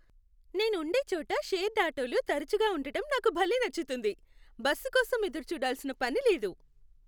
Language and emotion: Telugu, happy